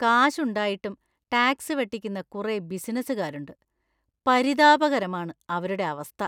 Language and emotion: Malayalam, disgusted